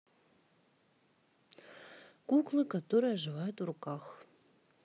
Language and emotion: Russian, neutral